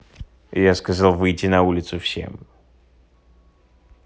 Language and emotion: Russian, angry